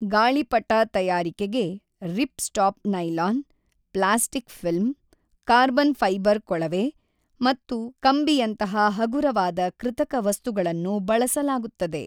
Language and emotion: Kannada, neutral